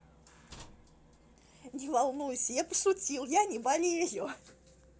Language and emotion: Russian, positive